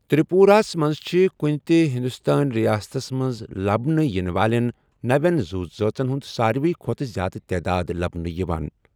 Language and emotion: Kashmiri, neutral